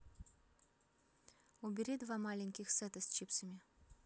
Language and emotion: Russian, neutral